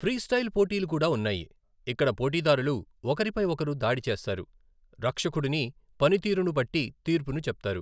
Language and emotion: Telugu, neutral